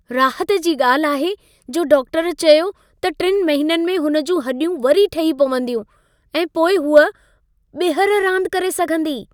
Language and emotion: Sindhi, happy